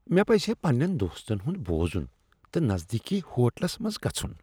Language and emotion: Kashmiri, disgusted